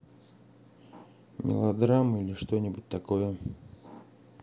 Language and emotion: Russian, neutral